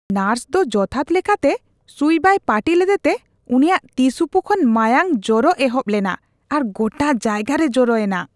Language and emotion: Santali, disgusted